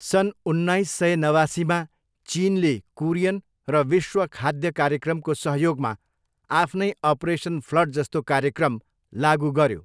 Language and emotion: Nepali, neutral